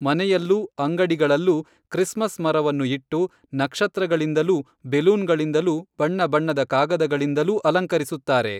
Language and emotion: Kannada, neutral